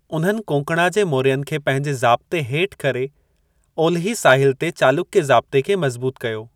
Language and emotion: Sindhi, neutral